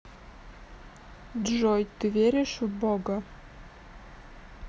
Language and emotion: Russian, neutral